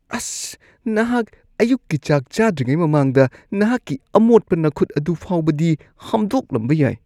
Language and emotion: Manipuri, disgusted